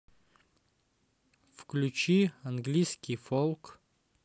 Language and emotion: Russian, neutral